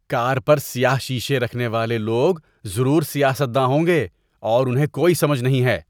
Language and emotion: Urdu, disgusted